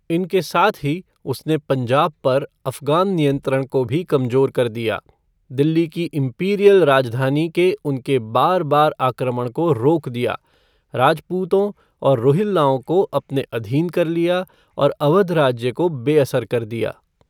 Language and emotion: Hindi, neutral